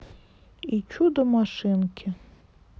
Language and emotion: Russian, sad